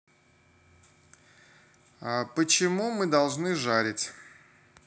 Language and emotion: Russian, neutral